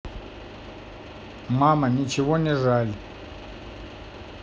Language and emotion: Russian, neutral